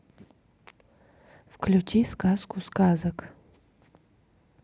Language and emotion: Russian, neutral